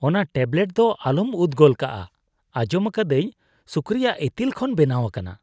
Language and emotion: Santali, disgusted